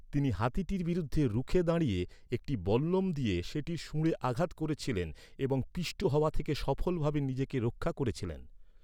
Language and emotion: Bengali, neutral